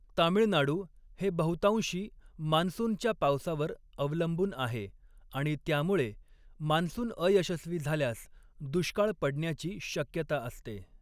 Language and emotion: Marathi, neutral